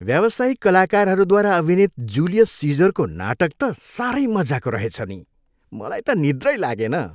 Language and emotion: Nepali, happy